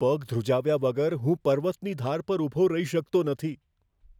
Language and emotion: Gujarati, fearful